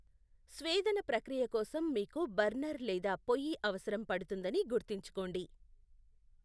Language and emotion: Telugu, neutral